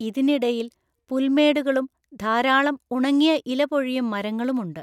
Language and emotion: Malayalam, neutral